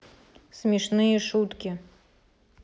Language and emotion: Russian, neutral